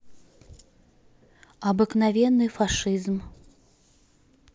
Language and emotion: Russian, neutral